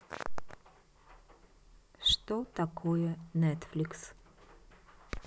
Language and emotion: Russian, neutral